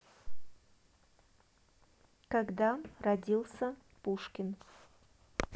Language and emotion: Russian, neutral